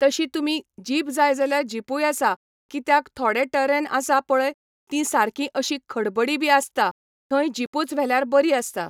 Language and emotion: Goan Konkani, neutral